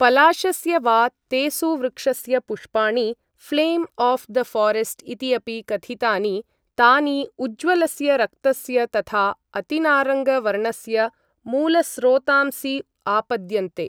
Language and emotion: Sanskrit, neutral